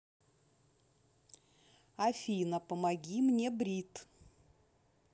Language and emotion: Russian, neutral